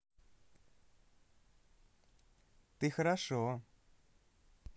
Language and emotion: Russian, positive